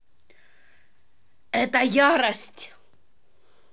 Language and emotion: Russian, angry